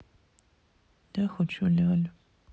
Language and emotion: Russian, sad